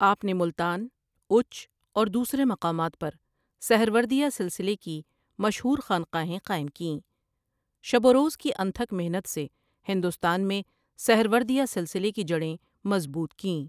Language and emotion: Urdu, neutral